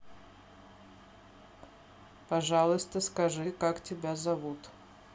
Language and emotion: Russian, neutral